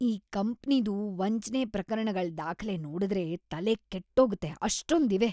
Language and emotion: Kannada, disgusted